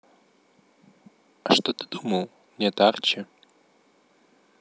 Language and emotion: Russian, neutral